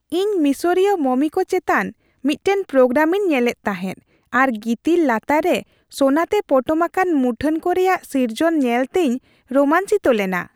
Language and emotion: Santali, happy